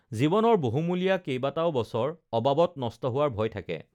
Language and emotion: Assamese, neutral